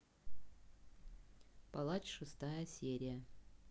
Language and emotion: Russian, neutral